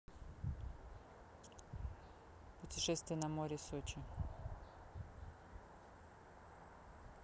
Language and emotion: Russian, neutral